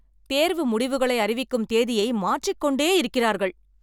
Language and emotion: Tamil, angry